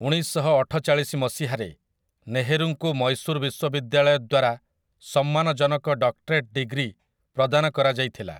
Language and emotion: Odia, neutral